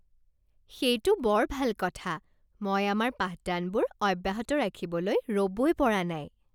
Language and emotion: Assamese, happy